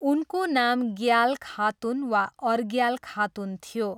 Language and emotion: Nepali, neutral